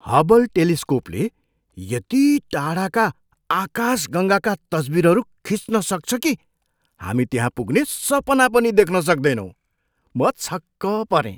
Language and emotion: Nepali, surprised